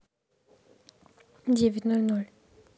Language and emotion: Russian, neutral